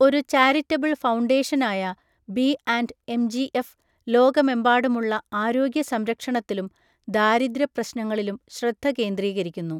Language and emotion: Malayalam, neutral